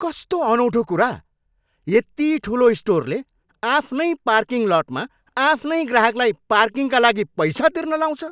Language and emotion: Nepali, angry